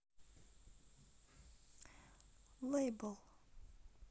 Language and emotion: Russian, neutral